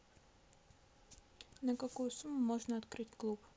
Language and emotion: Russian, neutral